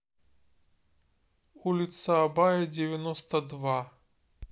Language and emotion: Russian, neutral